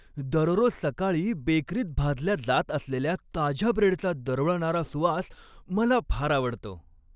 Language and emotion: Marathi, happy